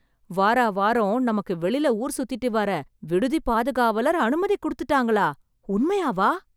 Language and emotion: Tamil, surprised